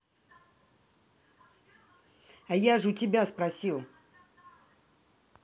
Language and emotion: Russian, angry